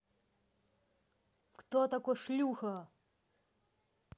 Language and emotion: Russian, angry